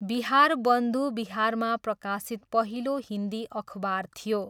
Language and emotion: Nepali, neutral